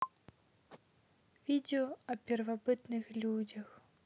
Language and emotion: Russian, neutral